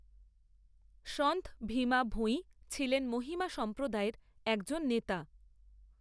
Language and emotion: Bengali, neutral